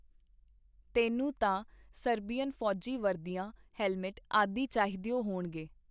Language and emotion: Punjabi, neutral